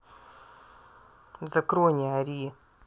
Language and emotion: Russian, angry